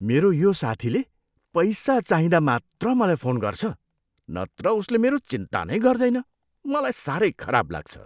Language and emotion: Nepali, disgusted